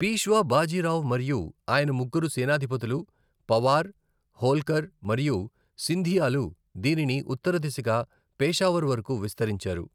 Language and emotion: Telugu, neutral